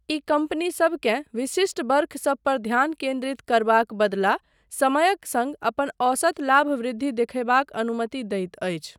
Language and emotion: Maithili, neutral